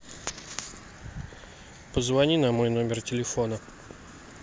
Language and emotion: Russian, neutral